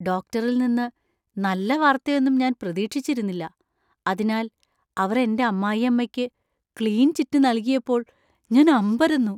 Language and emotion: Malayalam, surprised